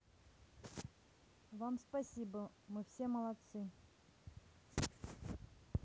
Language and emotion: Russian, neutral